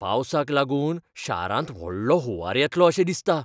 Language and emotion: Goan Konkani, fearful